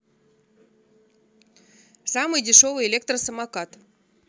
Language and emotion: Russian, neutral